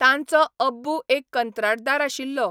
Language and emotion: Goan Konkani, neutral